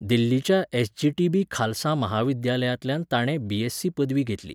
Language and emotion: Goan Konkani, neutral